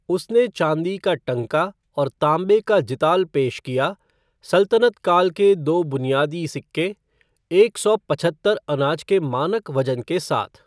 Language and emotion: Hindi, neutral